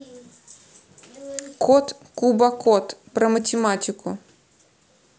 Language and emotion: Russian, neutral